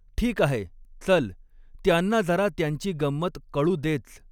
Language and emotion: Marathi, neutral